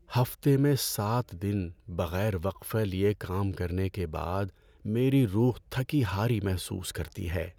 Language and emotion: Urdu, sad